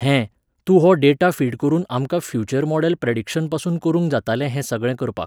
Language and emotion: Goan Konkani, neutral